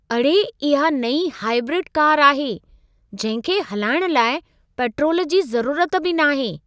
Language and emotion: Sindhi, surprised